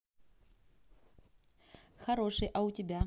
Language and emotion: Russian, positive